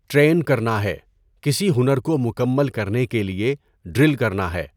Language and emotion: Urdu, neutral